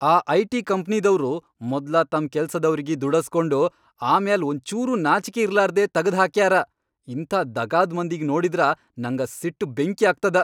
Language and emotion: Kannada, angry